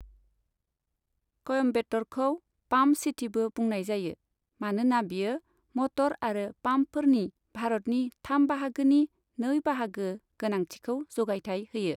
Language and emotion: Bodo, neutral